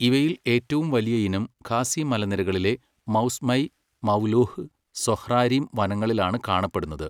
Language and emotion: Malayalam, neutral